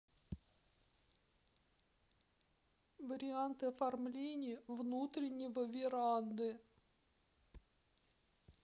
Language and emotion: Russian, sad